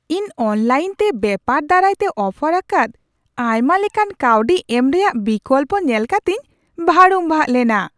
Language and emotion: Santali, surprised